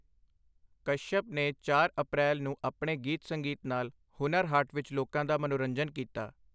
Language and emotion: Punjabi, neutral